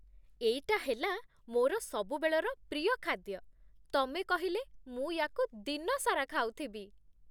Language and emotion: Odia, happy